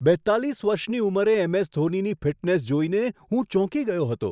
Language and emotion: Gujarati, surprised